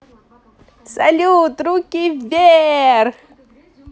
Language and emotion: Russian, positive